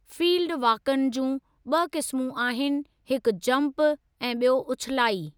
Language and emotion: Sindhi, neutral